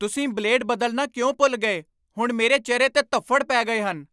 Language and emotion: Punjabi, angry